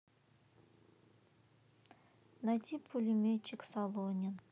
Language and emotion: Russian, neutral